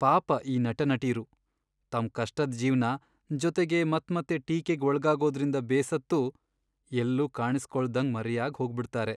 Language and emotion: Kannada, sad